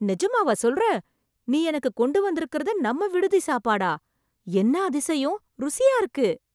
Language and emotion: Tamil, surprised